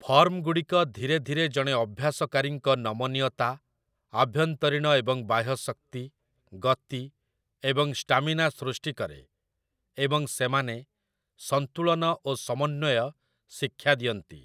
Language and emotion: Odia, neutral